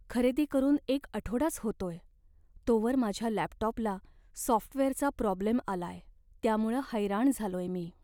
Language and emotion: Marathi, sad